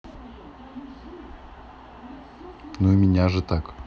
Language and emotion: Russian, neutral